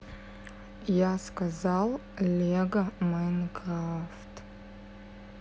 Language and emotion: Russian, sad